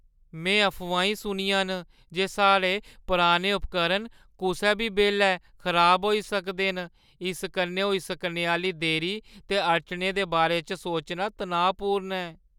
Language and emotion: Dogri, fearful